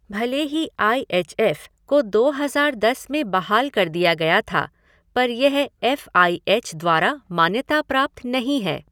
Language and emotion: Hindi, neutral